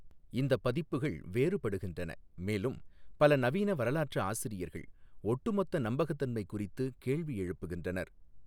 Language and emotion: Tamil, neutral